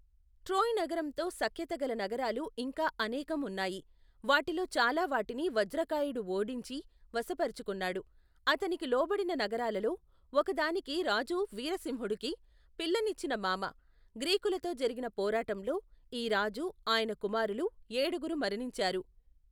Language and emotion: Telugu, neutral